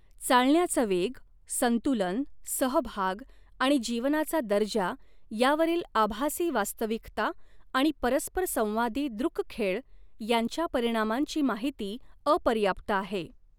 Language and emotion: Marathi, neutral